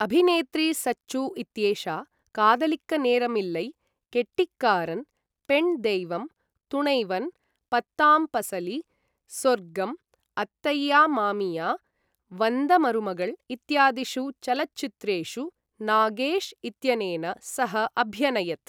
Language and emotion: Sanskrit, neutral